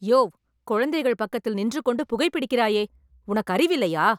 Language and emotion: Tamil, angry